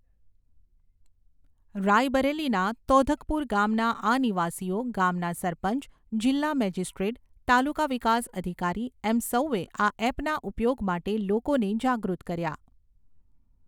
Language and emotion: Gujarati, neutral